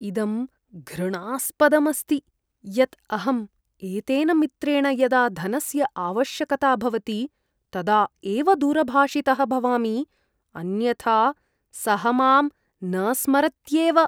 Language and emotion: Sanskrit, disgusted